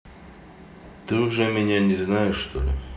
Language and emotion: Russian, neutral